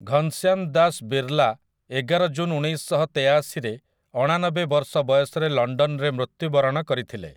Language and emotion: Odia, neutral